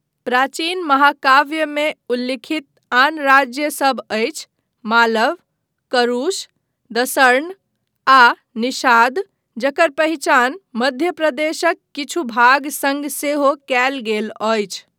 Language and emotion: Maithili, neutral